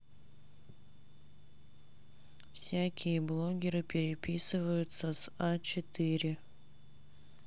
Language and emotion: Russian, sad